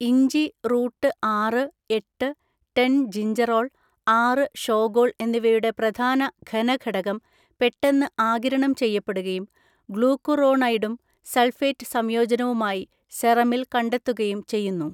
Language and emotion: Malayalam, neutral